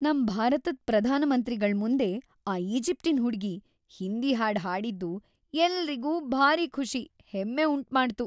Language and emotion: Kannada, happy